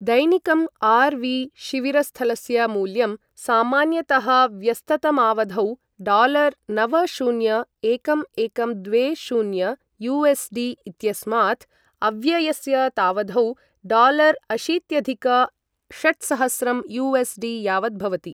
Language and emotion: Sanskrit, neutral